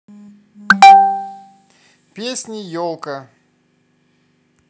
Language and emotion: Russian, positive